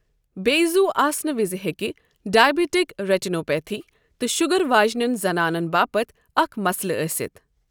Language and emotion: Kashmiri, neutral